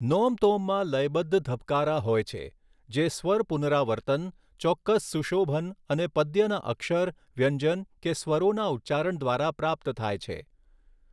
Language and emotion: Gujarati, neutral